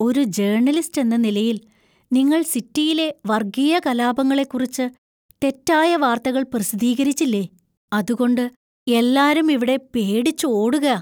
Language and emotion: Malayalam, fearful